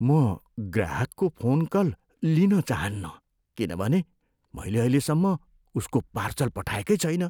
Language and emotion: Nepali, fearful